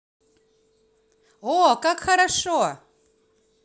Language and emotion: Russian, positive